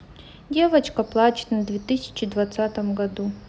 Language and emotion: Russian, sad